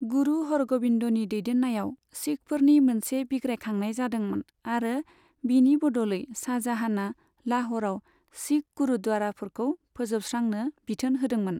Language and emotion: Bodo, neutral